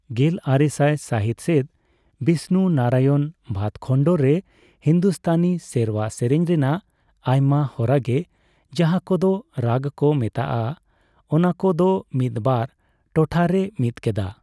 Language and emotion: Santali, neutral